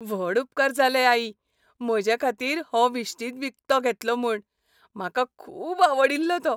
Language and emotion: Goan Konkani, happy